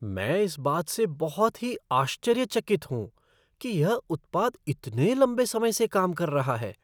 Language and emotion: Hindi, surprised